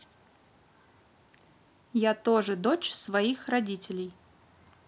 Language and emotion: Russian, neutral